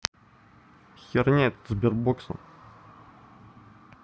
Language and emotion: Russian, angry